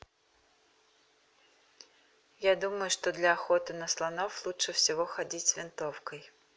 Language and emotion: Russian, neutral